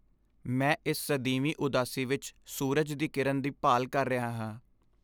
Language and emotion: Punjabi, sad